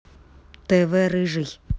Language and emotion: Russian, neutral